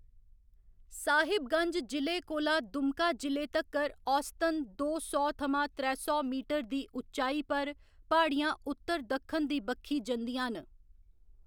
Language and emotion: Dogri, neutral